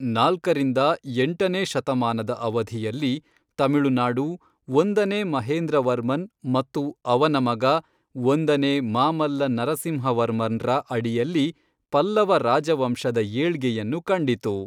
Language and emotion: Kannada, neutral